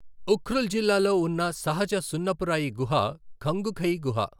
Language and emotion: Telugu, neutral